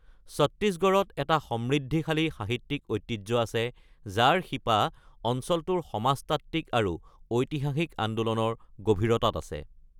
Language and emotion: Assamese, neutral